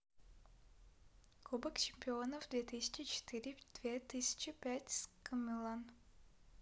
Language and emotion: Russian, neutral